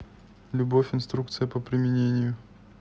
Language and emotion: Russian, neutral